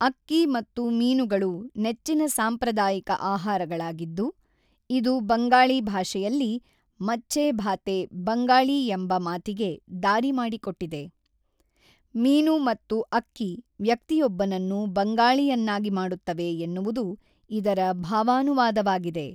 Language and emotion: Kannada, neutral